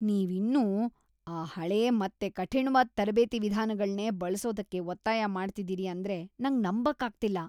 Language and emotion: Kannada, disgusted